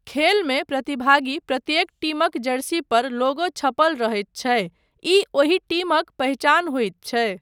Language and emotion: Maithili, neutral